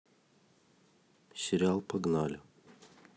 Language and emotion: Russian, neutral